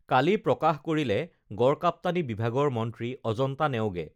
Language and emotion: Assamese, neutral